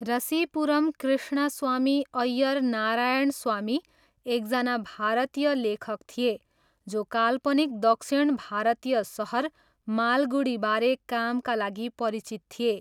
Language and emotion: Nepali, neutral